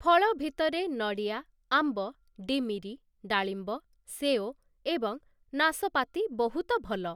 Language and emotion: Odia, neutral